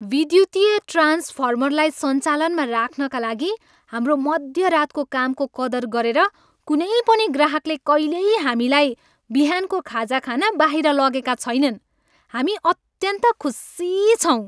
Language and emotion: Nepali, happy